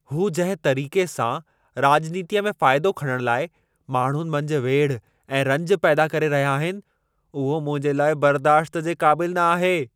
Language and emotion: Sindhi, angry